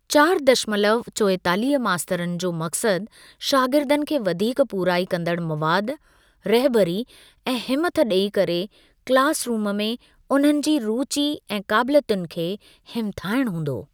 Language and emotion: Sindhi, neutral